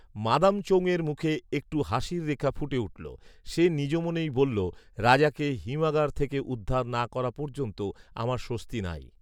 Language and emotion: Bengali, neutral